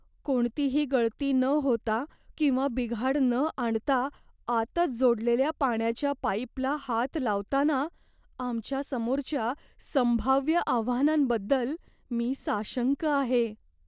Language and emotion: Marathi, fearful